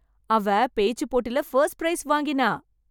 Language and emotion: Tamil, happy